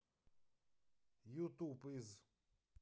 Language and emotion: Russian, neutral